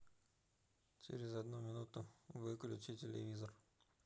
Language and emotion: Russian, neutral